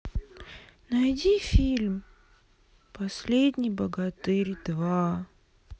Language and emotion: Russian, sad